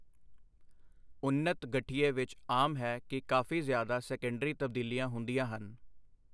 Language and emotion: Punjabi, neutral